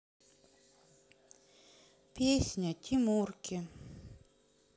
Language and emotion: Russian, sad